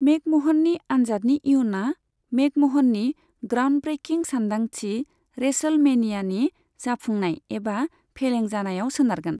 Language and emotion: Bodo, neutral